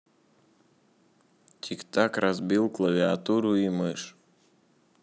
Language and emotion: Russian, neutral